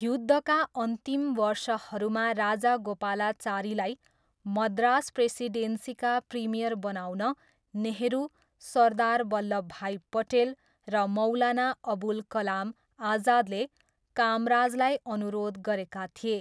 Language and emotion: Nepali, neutral